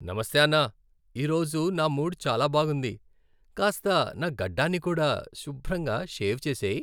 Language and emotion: Telugu, happy